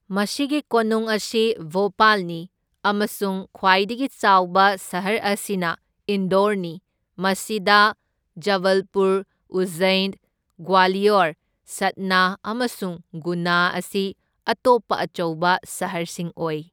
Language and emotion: Manipuri, neutral